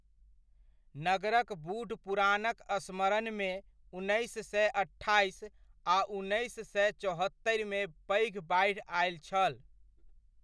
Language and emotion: Maithili, neutral